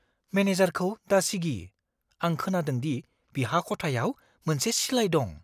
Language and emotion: Bodo, fearful